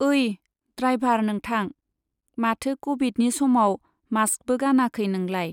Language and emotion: Bodo, neutral